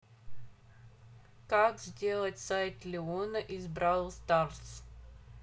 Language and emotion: Russian, neutral